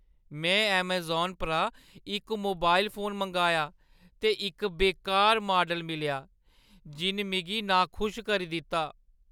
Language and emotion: Dogri, sad